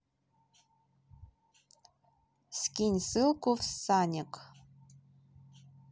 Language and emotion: Russian, neutral